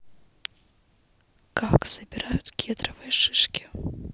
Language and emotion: Russian, neutral